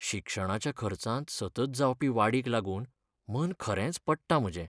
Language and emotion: Goan Konkani, sad